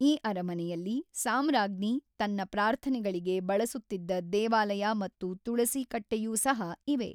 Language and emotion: Kannada, neutral